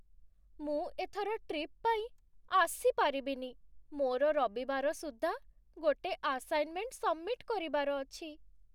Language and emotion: Odia, sad